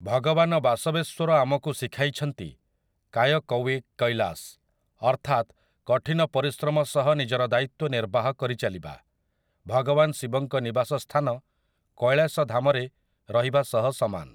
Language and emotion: Odia, neutral